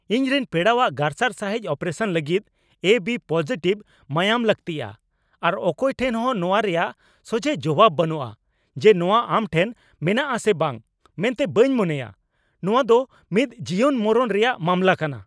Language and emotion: Santali, angry